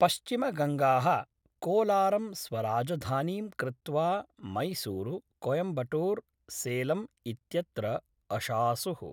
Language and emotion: Sanskrit, neutral